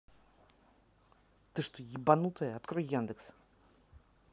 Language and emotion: Russian, angry